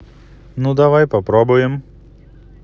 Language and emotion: Russian, positive